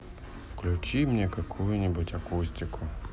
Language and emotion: Russian, sad